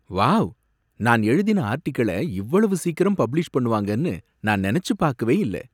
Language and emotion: Tamil, surprised